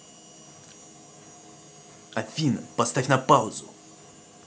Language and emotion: Russian, angry